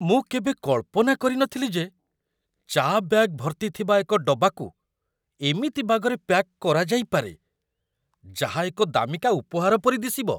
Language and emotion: Odia, surprised